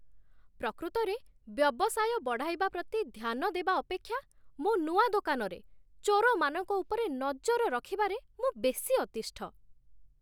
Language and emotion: Odia, disgusted